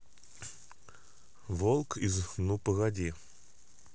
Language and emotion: Russian, neutral